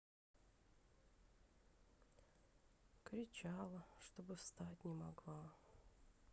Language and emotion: Russian, sad